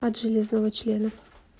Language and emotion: Russian, neutral